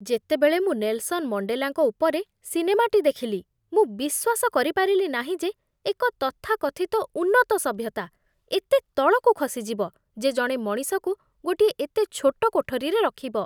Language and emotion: Odia, disgusted